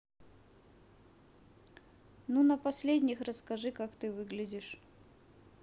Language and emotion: Russian, neutral